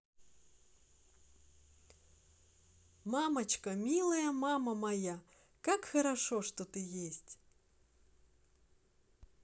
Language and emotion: Russian, positive